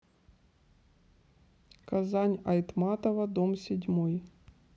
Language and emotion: Russian, neutral